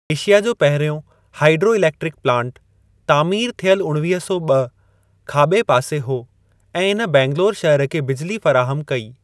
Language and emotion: Sindhi, neutral